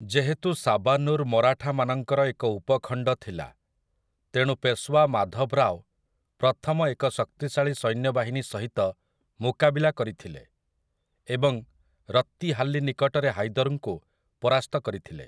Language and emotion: Odia, neutral